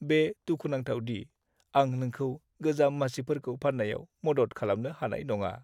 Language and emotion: Bodo, sad